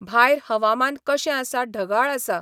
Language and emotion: Goan Konkani, neutral